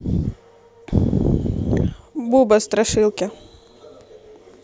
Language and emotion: Russian, neutral